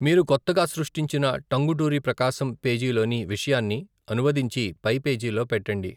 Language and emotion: Telugu, neutral